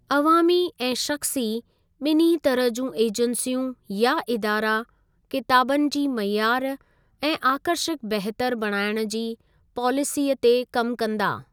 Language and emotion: Sindhi, neutral